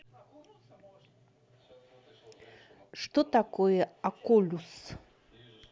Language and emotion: Russian, neutral